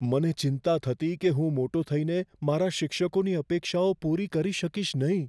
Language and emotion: Gujarati, fearful